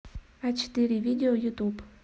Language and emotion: Russian, neutral